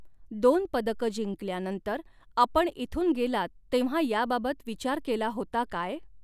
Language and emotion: Marathi, neutral